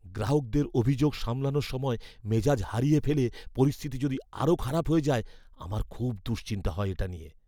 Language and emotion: Bengali, fearful